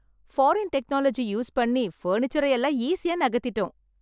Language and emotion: Tamil, happy